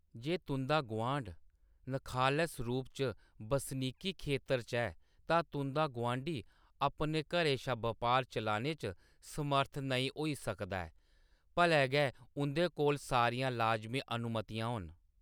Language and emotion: Dogri, neutral